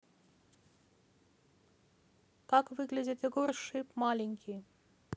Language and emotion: Russian, neutral